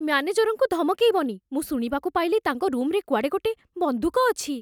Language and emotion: Odia, fearful